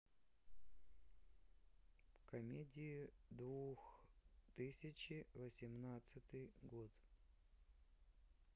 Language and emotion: Russian, neutral